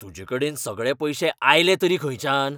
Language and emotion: Goan Konkani, angry